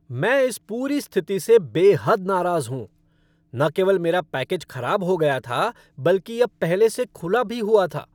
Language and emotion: Hindi, angry